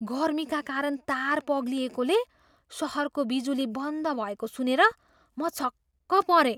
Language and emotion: Nepali, surprised